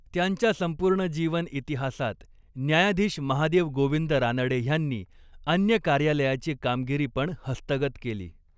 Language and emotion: Marathi, neutral